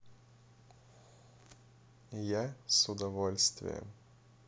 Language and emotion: Russian, positive